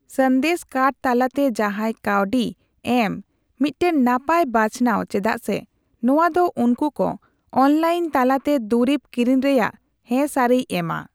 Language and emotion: Santali, neutral